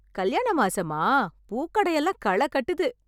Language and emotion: Tamil, happy